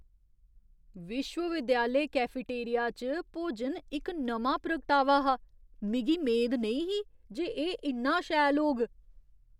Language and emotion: Dogri, surprised